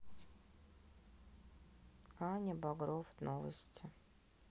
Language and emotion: Russian, sad